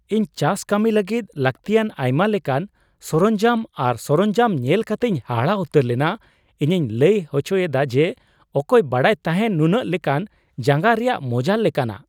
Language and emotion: Santali, surprised